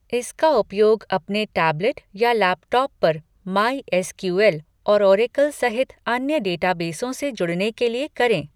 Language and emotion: Hindi, neutral